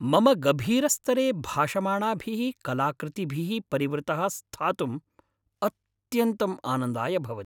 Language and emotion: Sanskrit, happy